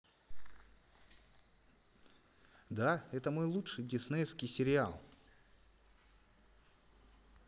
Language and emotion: Russian, positive